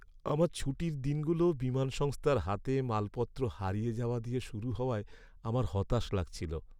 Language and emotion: Bengali, sad